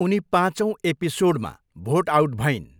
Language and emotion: Nepali, neutral